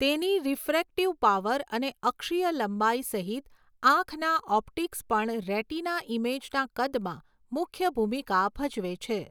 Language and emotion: Gujarati, neutral